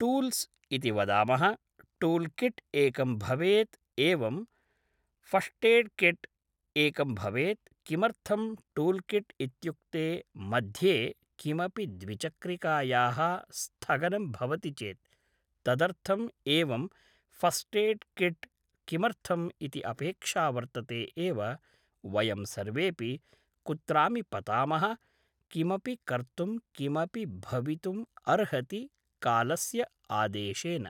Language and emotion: Sanskrit, neutral